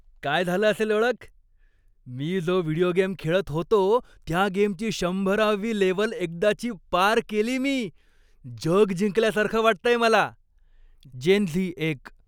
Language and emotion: Marathi, happy